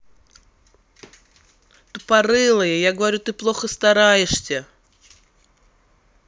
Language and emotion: Russian, angry